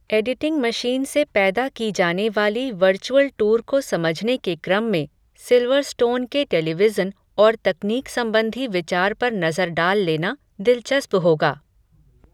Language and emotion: Hindi, neutral